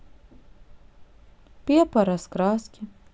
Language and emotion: Russian, sad